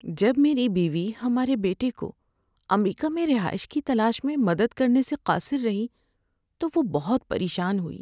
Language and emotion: Urdu, sad